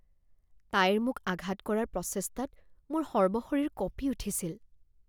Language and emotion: Assamese, fearful